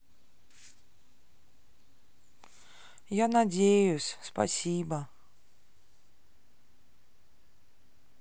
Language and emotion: Russian, sad